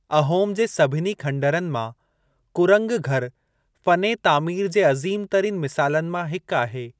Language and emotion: Sindhi, neutral